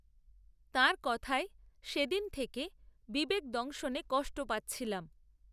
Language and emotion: Bengali, neutral